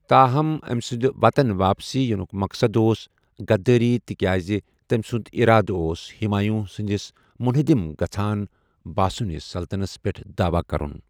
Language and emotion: Kashmiri, neutral